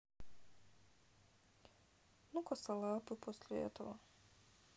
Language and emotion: Russian, sad